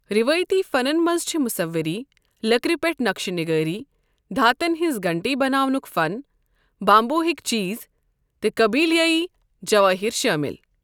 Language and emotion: Kashmiri, neutral